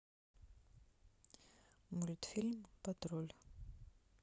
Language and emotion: Russian, sad